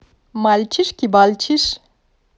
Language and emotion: Russian, positive